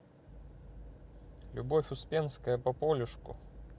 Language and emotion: Russian, neutral